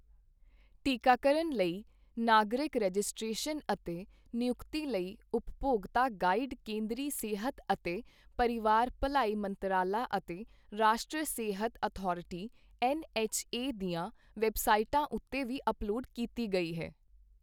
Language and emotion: Punjabi, neutral